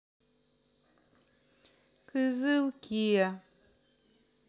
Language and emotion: Russian, neutral